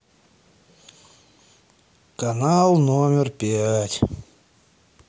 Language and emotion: Russian, sad